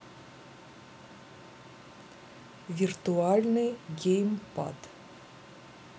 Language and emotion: Russian, neutral